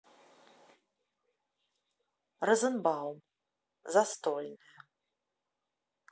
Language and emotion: Russian, neutral